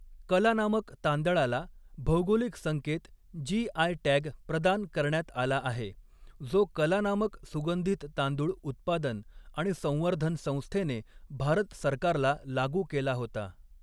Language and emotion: Marathi, neutral